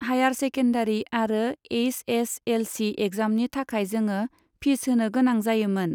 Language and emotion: Bodo, neutral